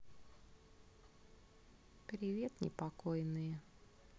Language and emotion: Russian, neutral